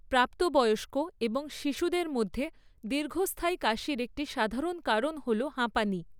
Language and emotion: Bengali, neutral